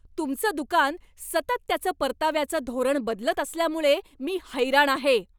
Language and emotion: Marathi, angry